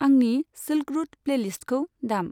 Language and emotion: Bodo, neutral